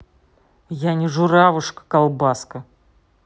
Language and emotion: Russian, angry